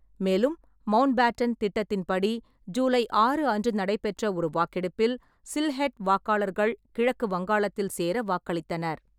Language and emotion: Tamil, neutral